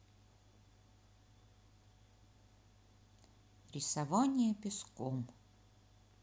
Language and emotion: Russian, neutral